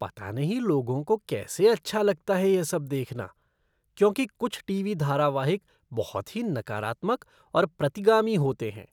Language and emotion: Hindi, disgusted